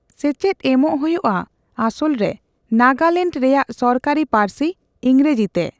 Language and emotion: Santali, neutral